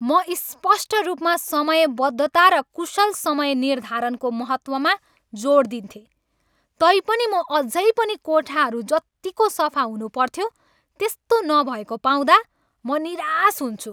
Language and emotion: Nepali, angry